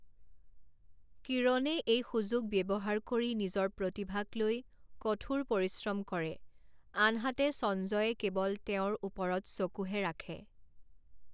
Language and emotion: Assamese, neutral